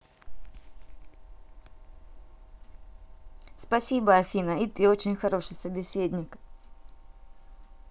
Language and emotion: Russian, positive